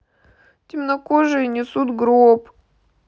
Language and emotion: Russian, sad